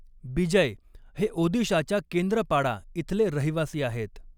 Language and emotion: Marathi, neutral